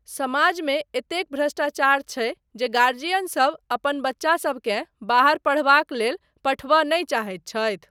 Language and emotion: Maithili, neutral